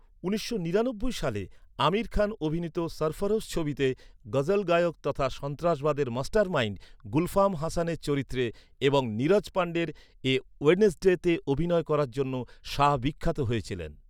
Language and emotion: Bengali, neutral